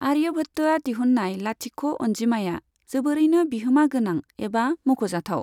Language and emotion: Bodo, neutral